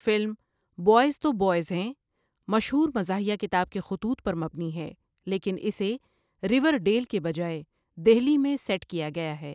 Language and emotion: Urdu, neutral